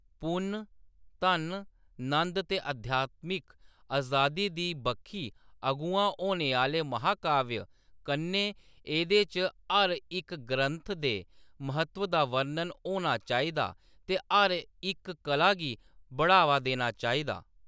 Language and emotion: Dogri, neutral